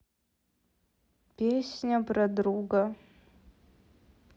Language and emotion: Russian, sad